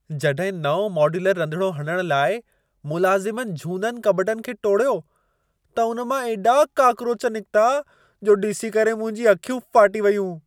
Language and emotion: Sindhi, surprised